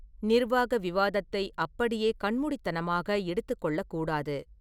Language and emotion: Tamil, neutral